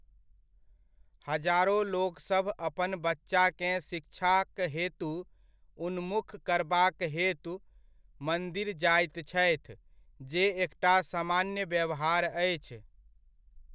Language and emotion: Maithili, neutral